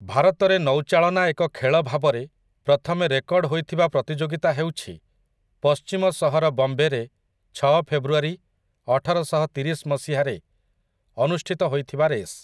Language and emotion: Odia, neutral